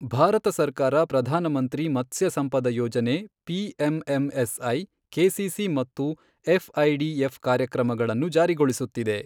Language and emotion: Kannada, neutral